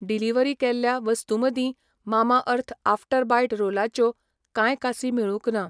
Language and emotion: Goan Konkani, neutral